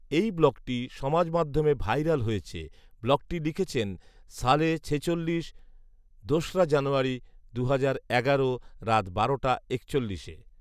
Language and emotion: Bengali, neutral